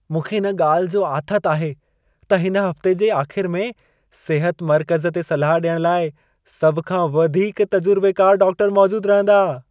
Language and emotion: Sindhi, happy